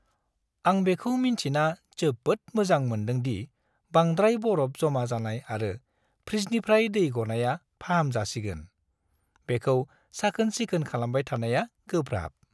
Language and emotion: Bodo, happy